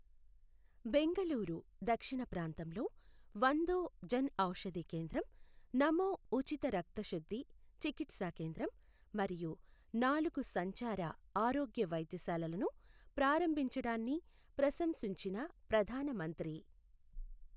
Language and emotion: Telugu, neutral